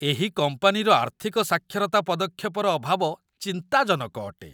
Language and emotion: Odia, disgusted